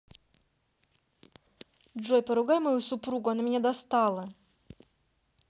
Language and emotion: Russian, angry